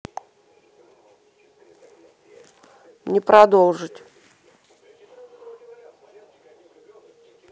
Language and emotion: Russian, neutral